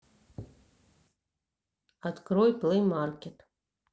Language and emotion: Russian, neutral